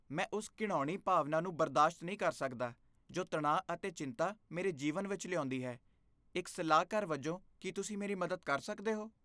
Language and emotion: Punjabi, disgusted